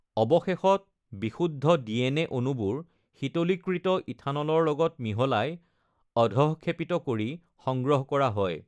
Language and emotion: Assamese, neutral